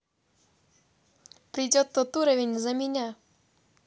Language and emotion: Russian, neutral